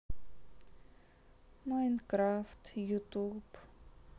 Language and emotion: Russian, sad